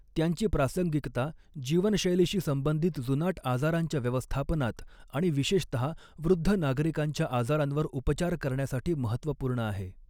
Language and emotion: Marathi, neutral